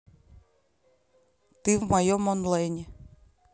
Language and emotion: Russian, neutral